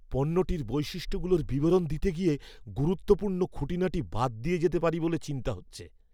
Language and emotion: Bengali, fearful